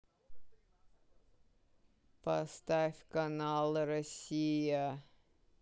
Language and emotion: Russian, sad